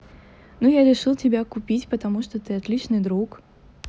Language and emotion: Russian, neutral